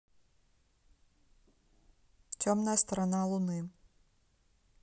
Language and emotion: Russian, neutral